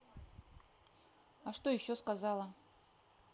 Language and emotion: Russian, neutral